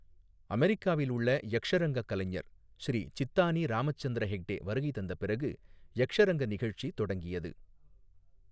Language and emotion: Tamil, neutral